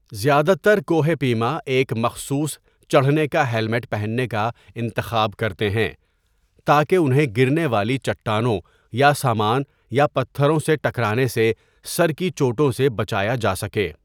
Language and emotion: Urdu, neutral